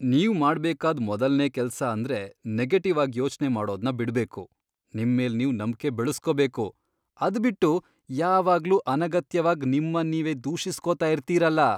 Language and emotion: Kannada, disgusted